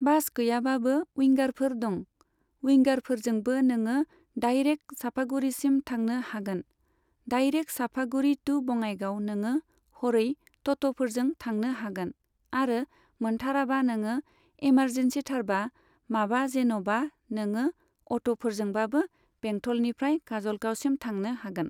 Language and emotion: Bodo, neutral